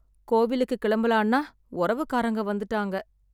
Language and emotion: Tamil, sad